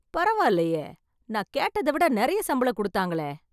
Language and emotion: Tamil, surprised